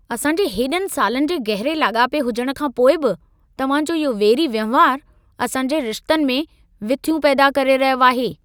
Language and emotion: Sindhi, angry